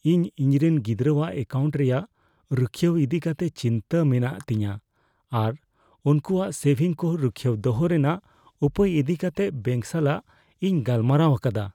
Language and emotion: Santali, fearful